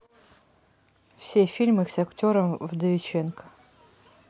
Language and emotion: Russian, neutral